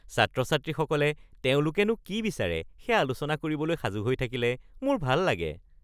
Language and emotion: Assamese, happy